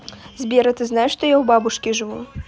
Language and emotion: Russian, neutral